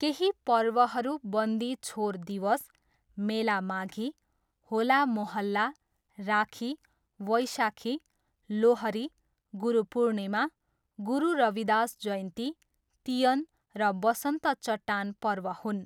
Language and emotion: Nepali, neutral